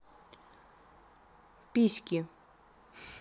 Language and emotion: Russian, neutral